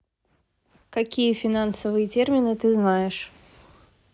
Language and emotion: Russian, neutral